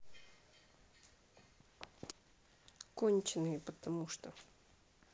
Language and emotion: Russian, neutral